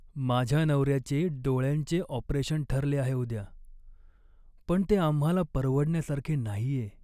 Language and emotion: Marathi, sad